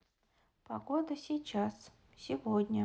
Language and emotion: Russian, neutral